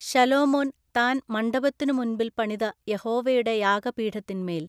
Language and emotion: Malayalam, neutral